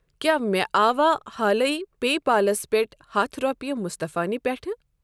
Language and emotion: Kashmiri, neutral